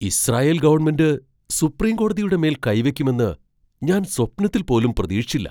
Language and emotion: Malayalam, surprised